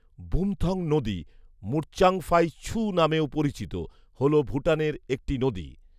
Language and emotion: Bengali, neutral